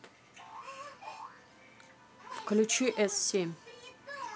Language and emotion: Russian, neutral